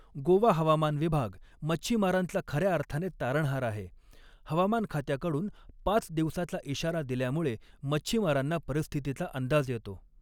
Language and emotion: Marathi, neutral